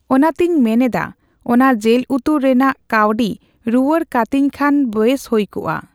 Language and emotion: Santali, neutral